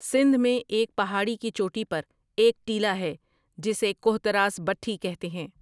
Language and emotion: Urdu, neutral